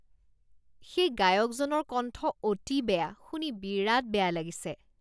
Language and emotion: Assamese, disgusted